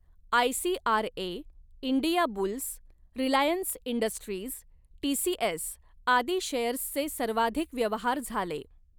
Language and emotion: Marathi, neutral